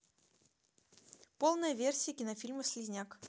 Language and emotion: Russian, neutral